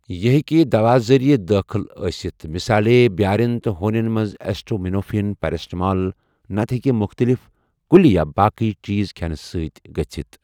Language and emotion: Kashmiri, neutral